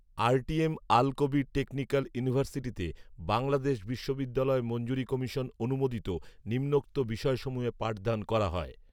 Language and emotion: Bengali, neutral